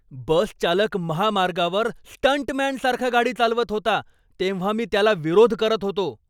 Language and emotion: Marathi, angry